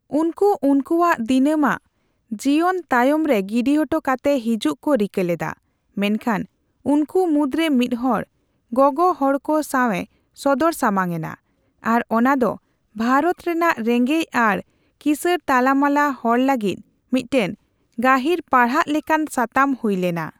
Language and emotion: Santali, neutral